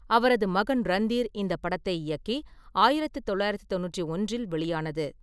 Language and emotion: Tamil, neutral